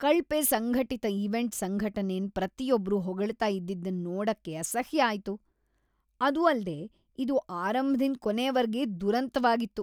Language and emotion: Kannada, disgusted